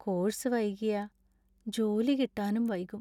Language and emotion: Malayalam, sad